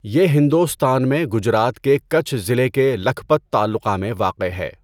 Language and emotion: Urdu, neutral